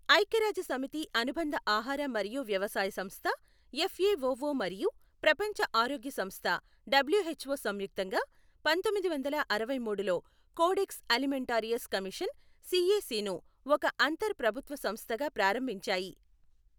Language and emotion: Telugu, neutral